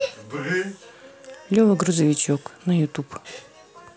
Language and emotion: Russian, neutral